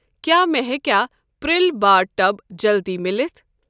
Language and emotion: Kashmiri, neutral